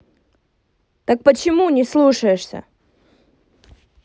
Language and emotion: Russian, angry